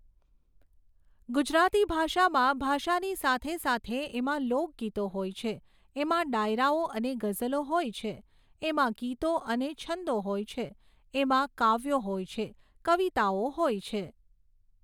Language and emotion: Gujarati, neutral